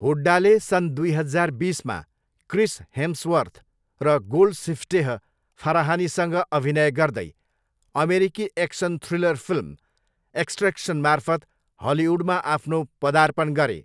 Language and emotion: Nepali, neutral